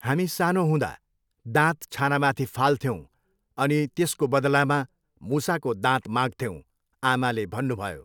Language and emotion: Nepali, neutral